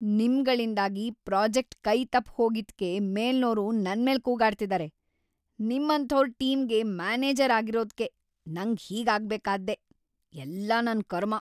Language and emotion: Kannada, angry